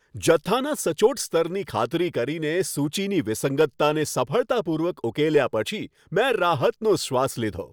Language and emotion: Gujarati, happy